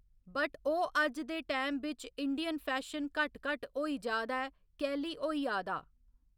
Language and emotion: Dogri, neutral